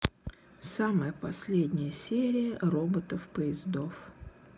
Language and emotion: Russian, sad